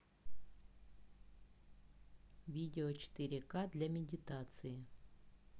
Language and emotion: Russian, neutral